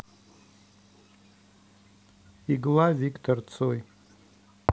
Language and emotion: Russian, neutral